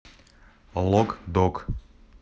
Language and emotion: Russian, neutral